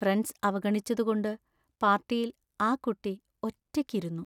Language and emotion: Malayalam, sad